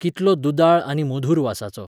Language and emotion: Goan Konkani, neutral